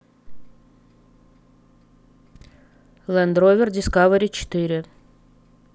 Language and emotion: Russian, neutral